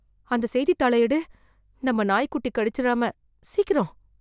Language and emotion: Tamil, fearful